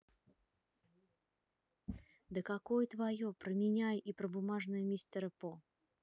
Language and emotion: Russian, angry